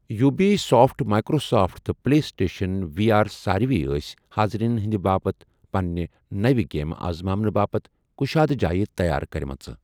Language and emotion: Kashmiri, neutral